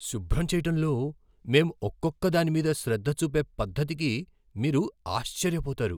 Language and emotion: Telugu, surprised